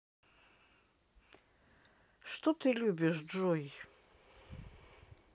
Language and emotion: Russian, neutral